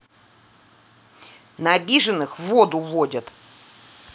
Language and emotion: Russian, angry